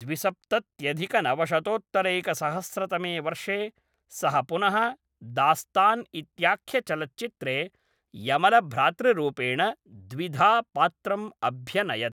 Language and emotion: Sanskrit, neutral